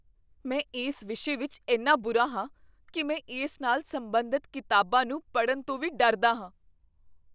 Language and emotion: Punjabi, fearful